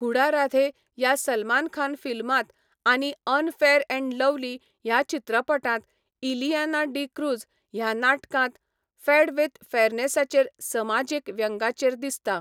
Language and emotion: Goan Konkani, neutral